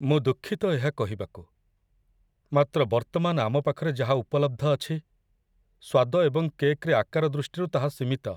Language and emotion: Odia, sad